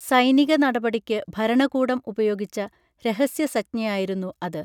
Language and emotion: Malayalam, neutral